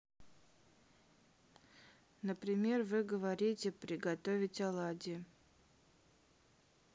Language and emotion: Russian, neutral